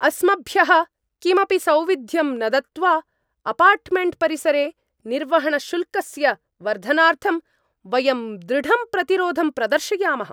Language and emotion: Sanskrit, angry